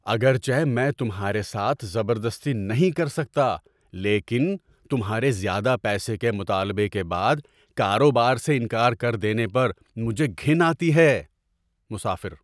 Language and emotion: Urdu, surprised